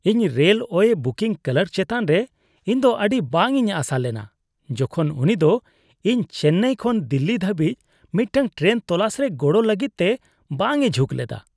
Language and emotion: Santali, disgusted